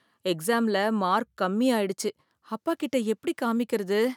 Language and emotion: Tamil, fearful